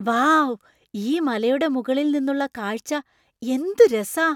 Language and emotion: Malayalam, surprised